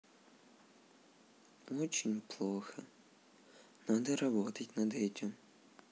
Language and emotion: Russian, sad